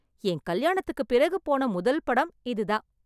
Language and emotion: Tamil, happy